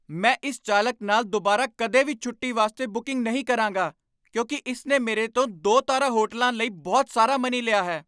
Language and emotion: Punjabi, angry